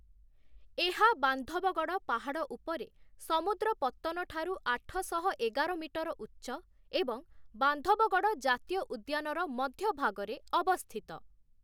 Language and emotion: Odia, neutral